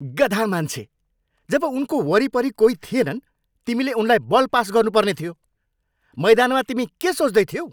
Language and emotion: Nepali, angry